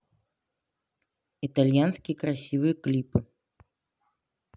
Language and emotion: Russian, neutral